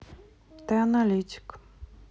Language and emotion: Russian, neutral